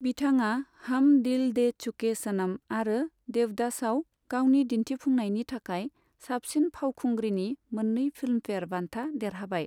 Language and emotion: Bodo, neutral